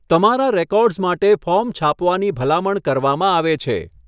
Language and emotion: Gujarati, neutral